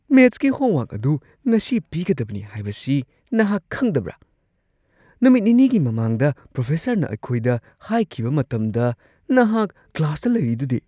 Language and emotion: Manipuri, surprised